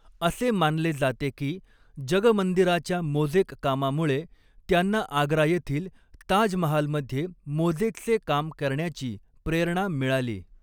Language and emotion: Marathi, neutral